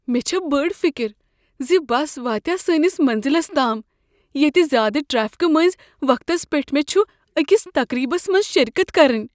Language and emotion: Kashmiri, fearful